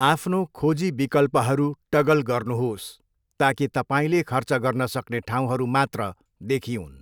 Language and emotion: Nepali, neutral